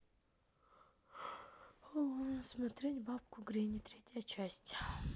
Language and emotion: Russian, neutral